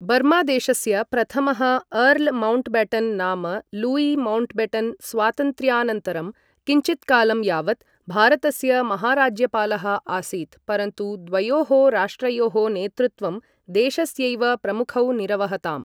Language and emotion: Sanskrit, neutral